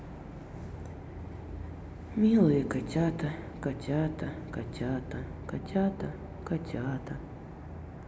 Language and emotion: Russian, sad